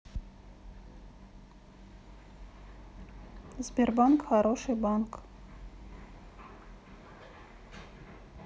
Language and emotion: Russian, neutral